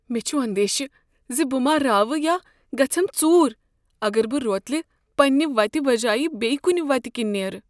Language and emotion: Kashmiri, fearful